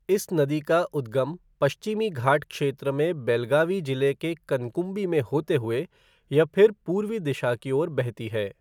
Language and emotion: Hindi, neutral